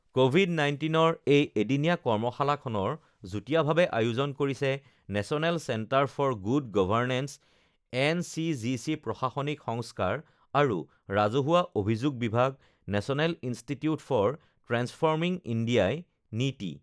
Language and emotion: Assamese, neutral